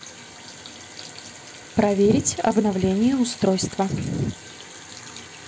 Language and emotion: Russian, neutral